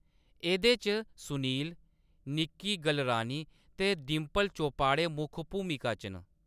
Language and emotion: Dogri, neutral